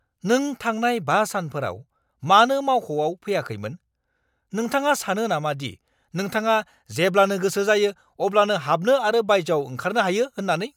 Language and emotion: Bodo, angry